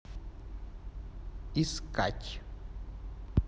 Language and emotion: Russian, neutral